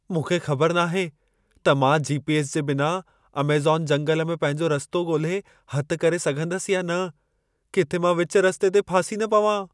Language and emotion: Sindhi, fearful